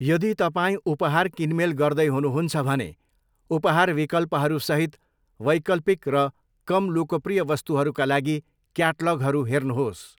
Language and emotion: Nepali, neutral